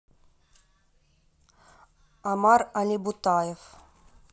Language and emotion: Russian, neutral